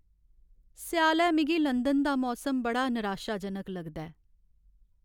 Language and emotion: Dogri, sad